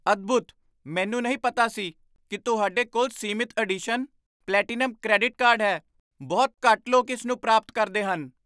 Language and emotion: Punjabi, surprised